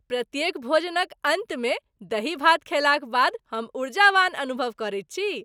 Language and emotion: Maithili, happy